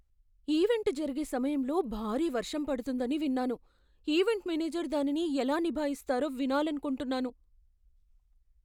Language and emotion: Telugu, fearful